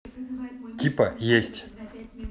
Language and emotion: Russian, neutral